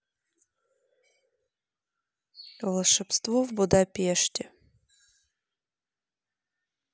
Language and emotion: Russian, neutral